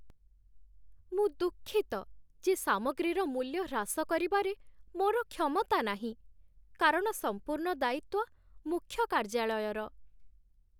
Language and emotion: Odia, sad